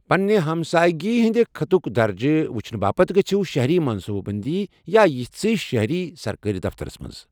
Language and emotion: Kashmiri, neutral